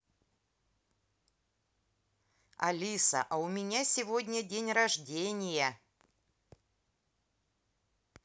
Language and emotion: Russian, positive